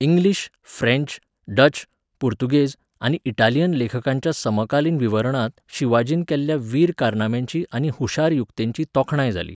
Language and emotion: Goan Konkani, neutral